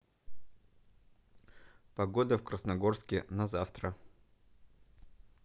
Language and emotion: Russian, neutral